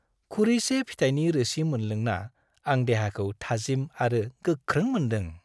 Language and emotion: Bodo, happy